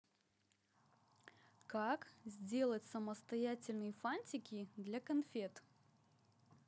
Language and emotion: Russian, positive